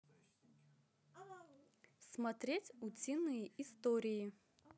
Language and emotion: Russian, positive